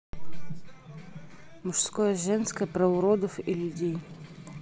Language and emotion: Russian, neutral